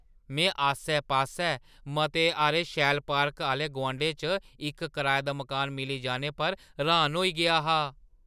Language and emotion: Dogri, surprised